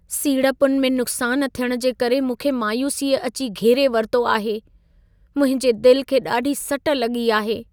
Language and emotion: Sindhi, sad